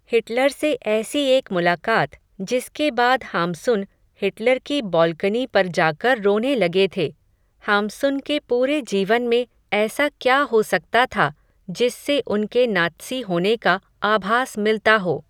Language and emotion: Hindi, neutral